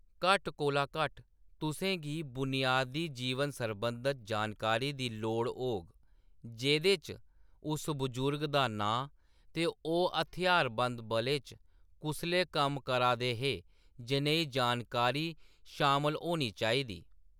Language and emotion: Dogri, neutral